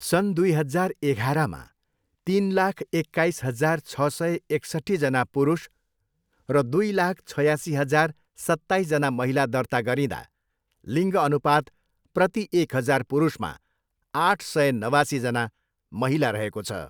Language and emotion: Nepali, neutral